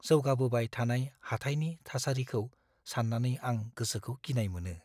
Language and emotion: Bodo, fearful